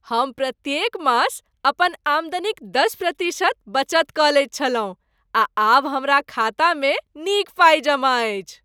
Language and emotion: Maithili, happy